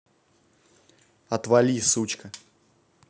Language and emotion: Russian, angry